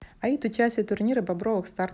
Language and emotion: Russian, neutral